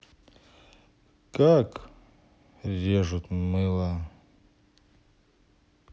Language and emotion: Russian, neutral